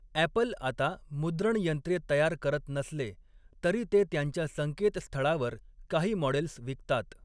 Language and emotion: Marathi, neutral